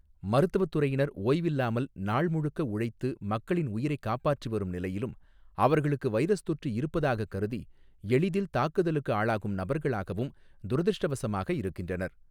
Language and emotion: Tamil, neutral